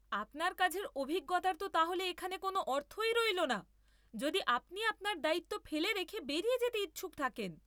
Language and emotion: Bengali, angry